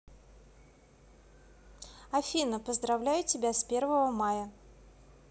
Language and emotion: Russian, positive